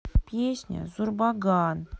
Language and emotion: Russian, sad